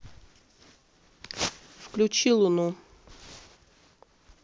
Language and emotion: Russian, neutral